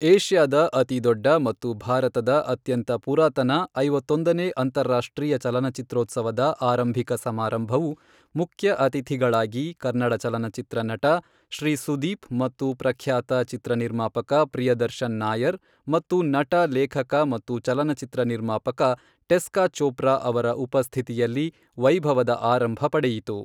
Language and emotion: Kannada, neutral